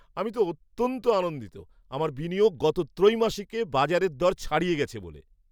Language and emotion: Bengali, happy